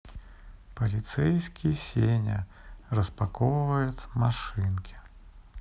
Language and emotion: Russian, neutral